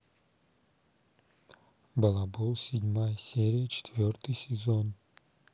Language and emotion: Russian, neutral